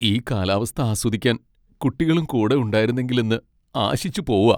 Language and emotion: Malayalam, sad